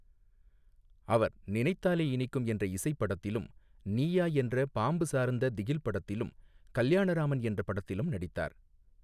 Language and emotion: Tamil, neutral